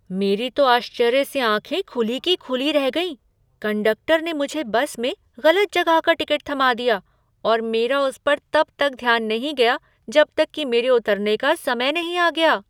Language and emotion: Hindi, surprised